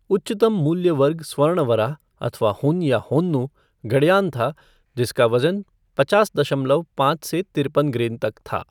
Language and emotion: Hindi, neutral